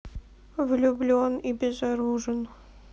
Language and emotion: Russian, sad